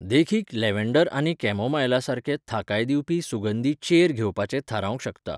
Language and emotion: Goan Konkani, neutral